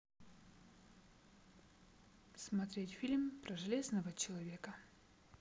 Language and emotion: Russian, neutral